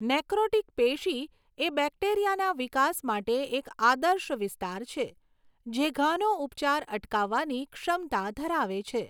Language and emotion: Gujarati, neutral